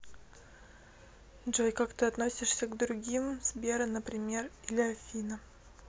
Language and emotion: Russian, neutral